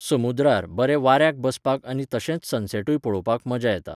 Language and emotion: Goan Konkani, neutral